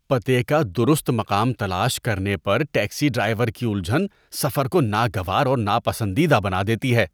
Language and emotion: Urdu, disgusted